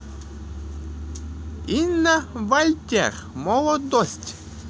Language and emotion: Russian, positive